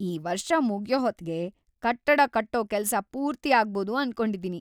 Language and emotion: Kannada, happy